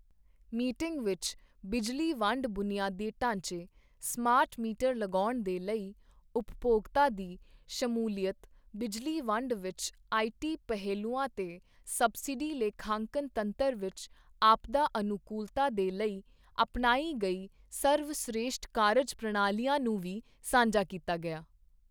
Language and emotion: Punjabi, neutral